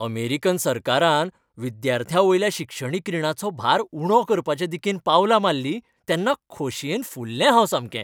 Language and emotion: Goan Konkani, happy